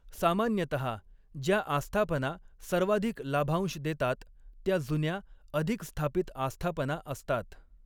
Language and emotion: Marathi, neutral